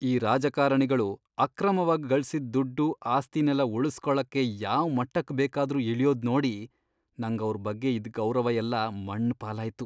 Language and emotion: Kannada, disgusted